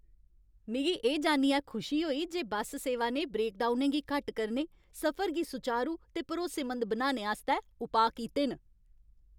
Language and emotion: Dogri, happy